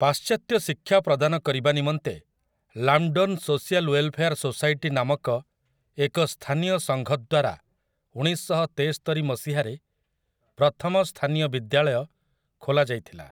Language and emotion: Odia, neutral